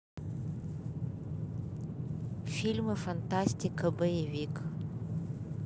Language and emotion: Russian, neutral